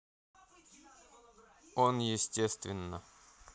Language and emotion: Russian, neutral